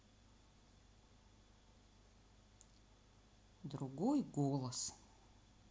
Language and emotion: Russian, sad